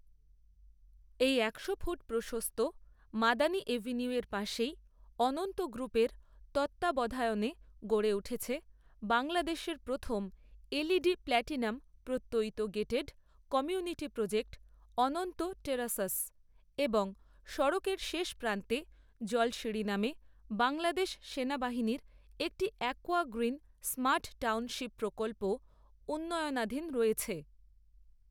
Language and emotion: Bengali, neutral